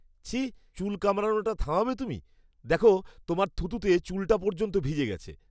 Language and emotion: Bengali, disgusted